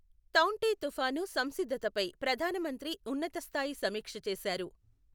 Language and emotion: Telugu, neutral